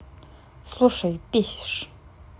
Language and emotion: Russian, angry